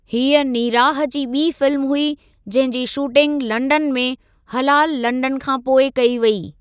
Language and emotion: Sindhi, neutral